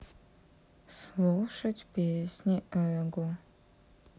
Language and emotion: Russian, sad